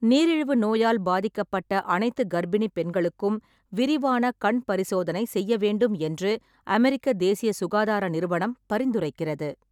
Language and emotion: Tamil, neutral